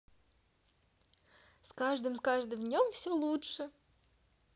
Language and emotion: Russian, positive